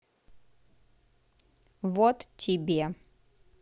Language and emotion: Russian, neutral